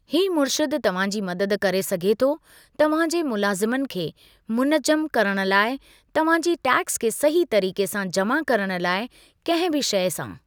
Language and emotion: Sindhi, neutral